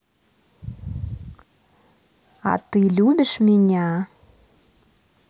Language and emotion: Russian, positive